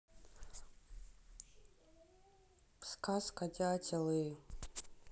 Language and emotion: Russian, neutral